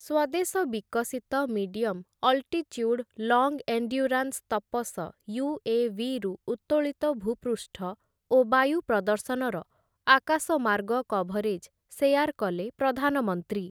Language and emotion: Odia, neutral